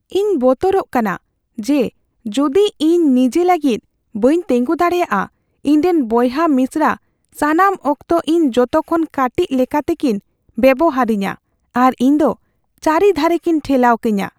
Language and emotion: Santali, fearful